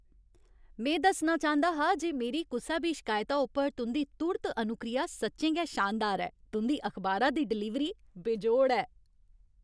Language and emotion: Dogri, happy